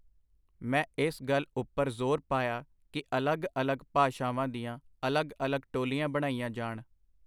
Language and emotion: Punjabi, neutral